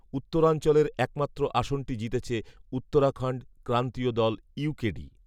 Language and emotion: Bengali, neutral